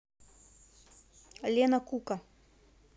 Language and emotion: Russian, neutral